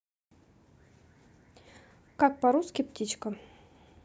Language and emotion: Russian, neutral